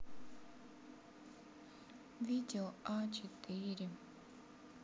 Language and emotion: Russian, sad